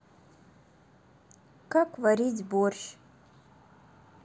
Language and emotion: Russian, neutral